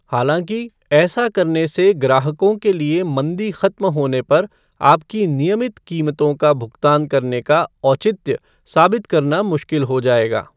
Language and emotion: Hindi, neutral